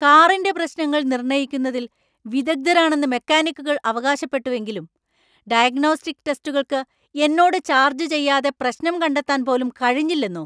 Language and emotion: Malayalam, angry